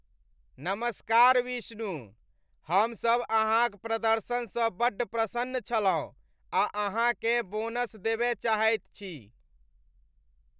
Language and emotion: Maithili, happy